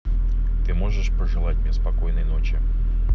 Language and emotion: Russian, neutral